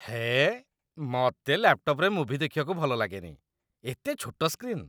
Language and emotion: Odia, disgusted